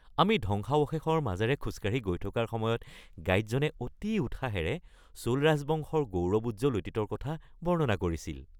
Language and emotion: Assamese, happy